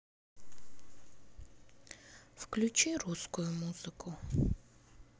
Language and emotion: Russian, sad